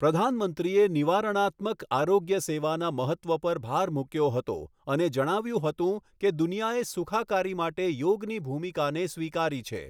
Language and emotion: Gujarati, neutral